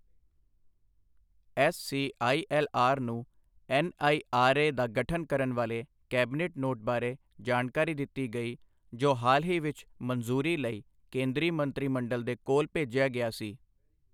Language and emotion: Punjabi, neutral